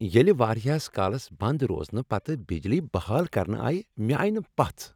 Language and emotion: Kashmiri, happy